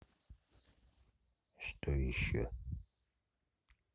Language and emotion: Russian, neutral